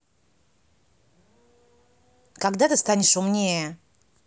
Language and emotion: Russian, angry